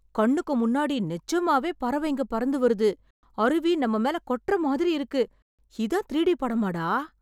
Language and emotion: Tamil, surprised